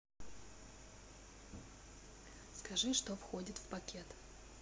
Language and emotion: Russian, neutral